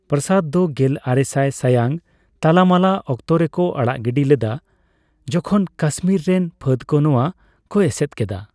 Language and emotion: Santali, neutral